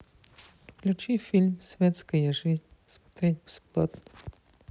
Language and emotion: Russian, sad